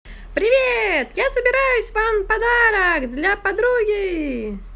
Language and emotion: Russian, positive